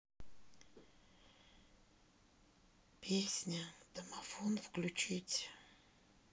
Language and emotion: Russian, sad